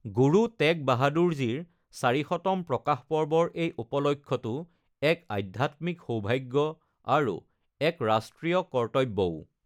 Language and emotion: Assamese, neutral